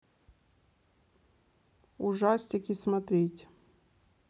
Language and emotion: Russian, neutral